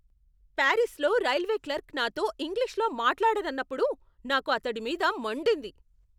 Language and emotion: Telugu, angry